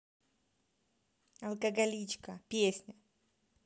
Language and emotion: Russian, neutral